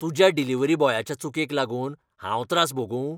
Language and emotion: Goan Konkani, angry